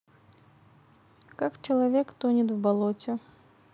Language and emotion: Russian, neutral